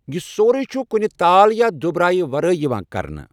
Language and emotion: Kashmiri, neutral